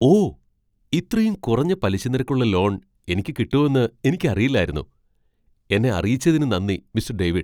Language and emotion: Malayalam, surprised